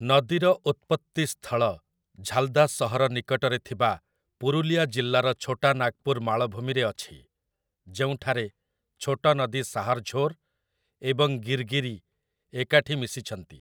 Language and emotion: Odia, neutral